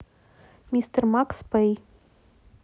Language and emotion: Russian, neutral